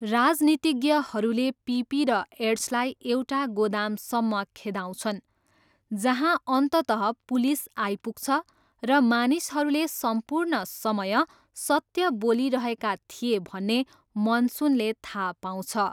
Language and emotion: Nepali, neutral